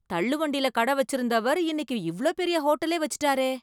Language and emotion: Tamil, surprised